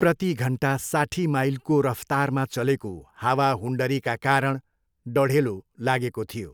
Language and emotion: Nepali, neutral